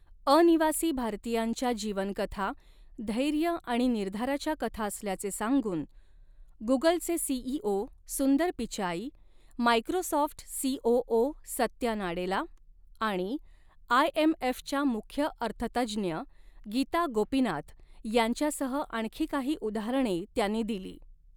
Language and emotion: Marathi, neutral